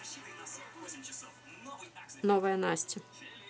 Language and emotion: Russian, neutral